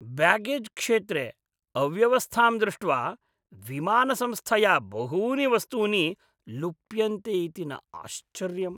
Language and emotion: Sanskrit, disgusted